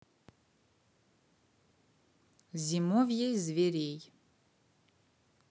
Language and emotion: Russian, neutral